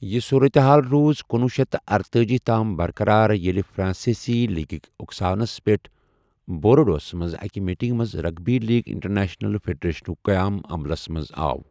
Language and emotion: Kashmiri, neutral